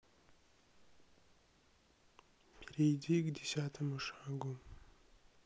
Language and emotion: Russian, sad